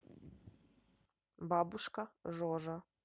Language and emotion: Russian, neutral